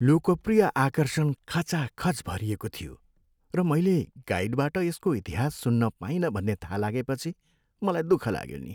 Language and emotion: Nepali, sad